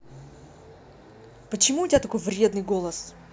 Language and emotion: Russian, angry